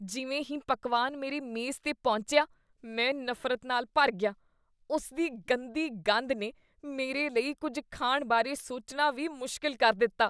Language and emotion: Punjabi, disgusted